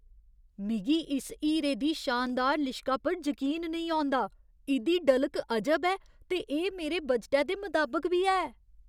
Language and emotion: Dogri, surprised